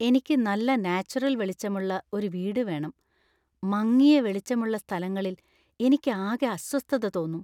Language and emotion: Malayalam, fearful